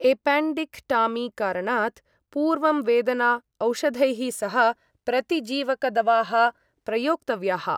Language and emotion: Sanskrit, neutral